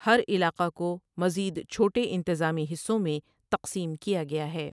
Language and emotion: Urdu, neutral